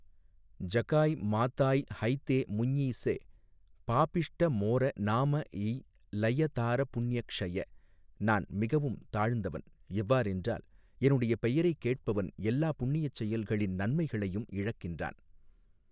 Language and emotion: Tamil, neutral